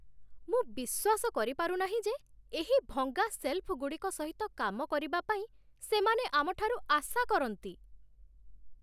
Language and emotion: Odia, disgusted